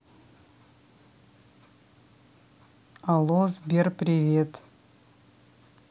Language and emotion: Russian, neutral